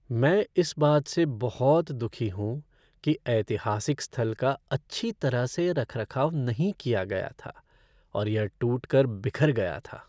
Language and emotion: Hindi, sad